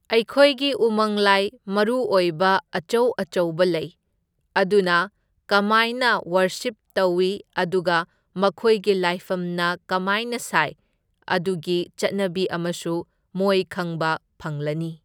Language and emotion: Manipuri, neutral